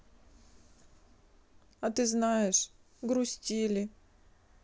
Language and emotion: Russian, sad